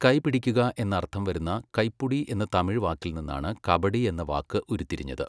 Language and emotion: Malayalam, neutral